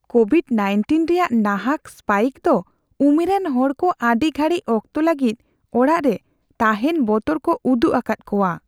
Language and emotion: Santali, fearful